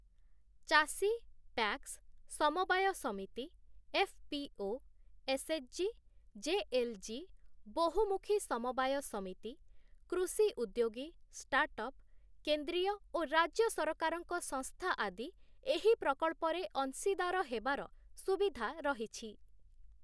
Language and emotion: Odia, neutral